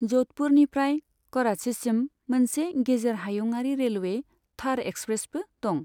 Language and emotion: Bodo, neutral